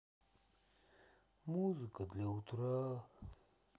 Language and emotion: Russian, sad